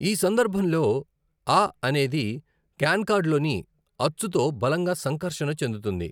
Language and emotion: Telugu, neutral